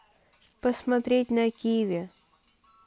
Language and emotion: Russian, neutral